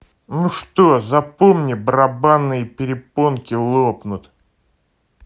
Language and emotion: Russian, angry